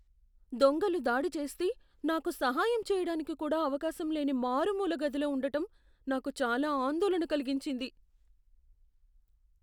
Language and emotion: Telugu, fearful